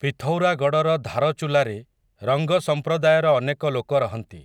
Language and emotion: Odia, neutral